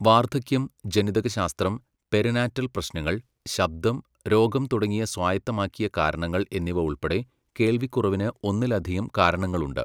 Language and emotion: Malayalam, neutral